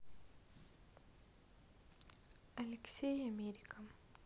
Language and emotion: Russian, neutral